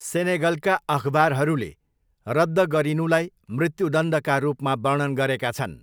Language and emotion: Nepali, neutral